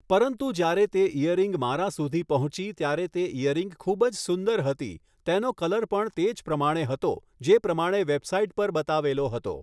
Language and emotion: Gujarati, neutral